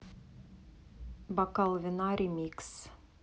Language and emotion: Russian, neutral